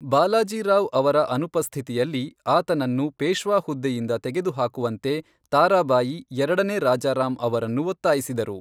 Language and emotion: Kannada, neutral